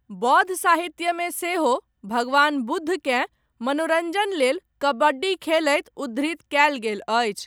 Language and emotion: Maithili, neutral